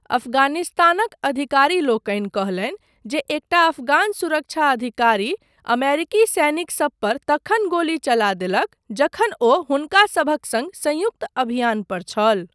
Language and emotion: Maithili, neutral